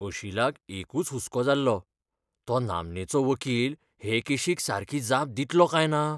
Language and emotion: Goan Konkani, fearful